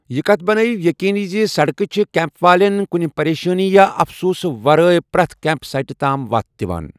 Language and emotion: Kashmiri, neutral